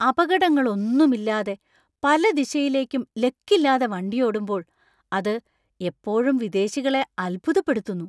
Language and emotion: Malayalam, surprised